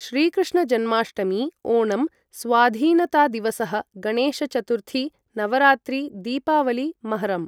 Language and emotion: Sanskrit, neutral